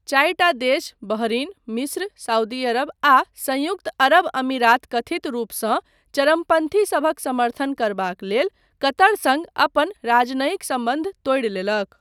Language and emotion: Maithili, neutral